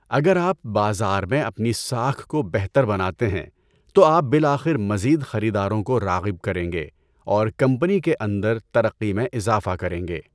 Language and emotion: Urdu, neutral